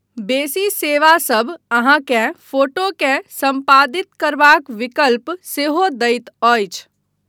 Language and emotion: Maithili, neutral